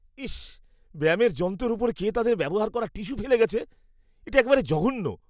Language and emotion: Bengali, disgusted